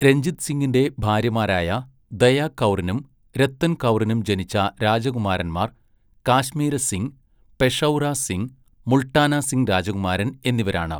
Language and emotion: Malayalam, neutral